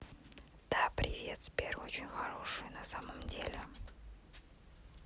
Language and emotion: Russian, neutral